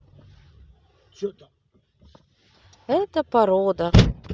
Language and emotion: Russian, neutral